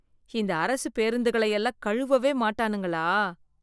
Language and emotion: Tamil, disgusted